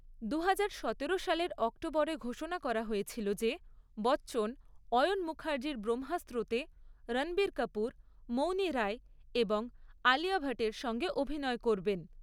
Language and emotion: Bengali, neutral